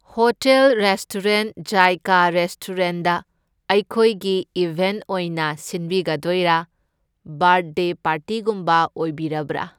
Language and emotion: Manipuri, neutral